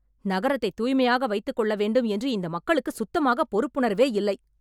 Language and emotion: Tamil, angry